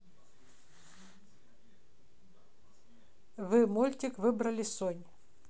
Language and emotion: Russian, neutral